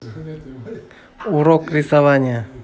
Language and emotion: Russian, neutral